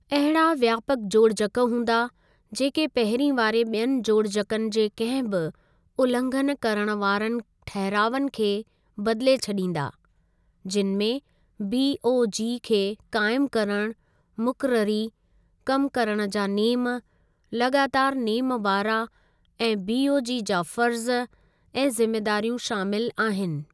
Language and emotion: Sindhi, neutral